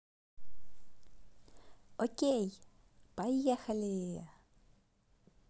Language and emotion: Russian, positive